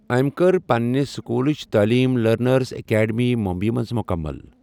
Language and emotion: Kashmiri, neutral